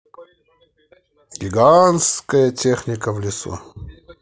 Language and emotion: Russian, positive